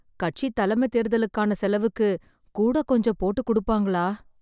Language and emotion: Tamil, sad